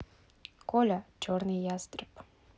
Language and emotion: Russian, neutral